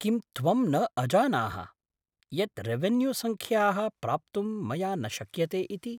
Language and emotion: Sanskrit, surprised